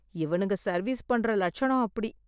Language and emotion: Tamil, disgusted